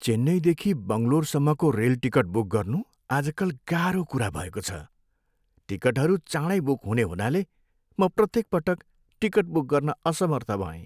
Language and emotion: Nepali, sad